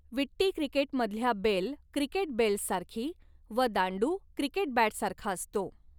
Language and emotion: Marathi, neutral